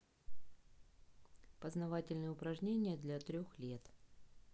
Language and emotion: Russian, neutral